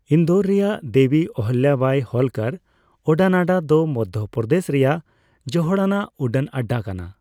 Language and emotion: Santali, neutral